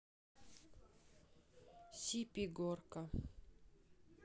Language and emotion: Russian, neutral